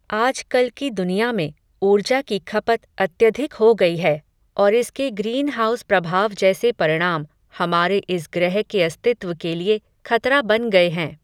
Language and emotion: Hindi, neutral